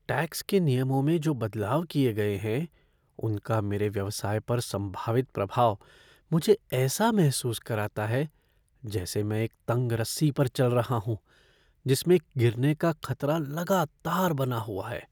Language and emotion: Hindi, fearful